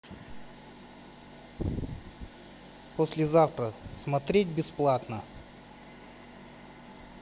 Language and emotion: Russian, neutral